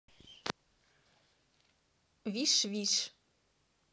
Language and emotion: Russian, neutral